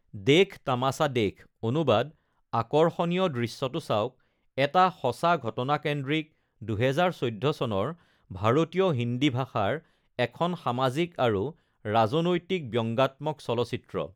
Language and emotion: Assamese, neutral